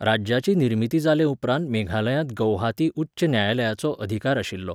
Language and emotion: Goan Konkani, neutral